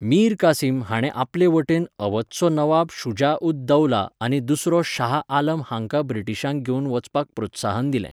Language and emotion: Goan Konkani, neutral